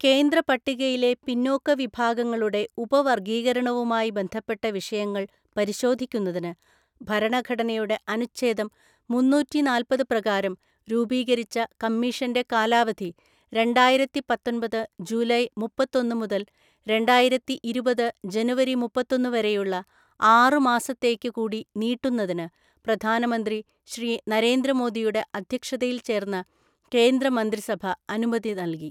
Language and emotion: Malayalam, neutral